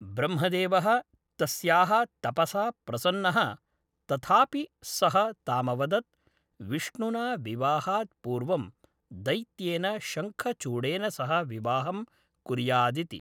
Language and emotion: Sanskrit, neutral